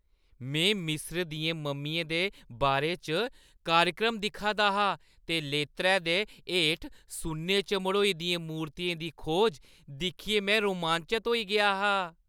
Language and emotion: Dogri, happy